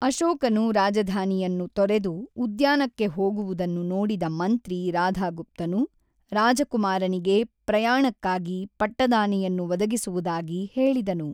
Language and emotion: Kannada, neutral